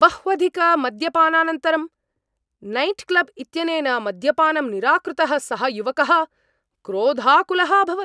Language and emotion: Sanskrit, angry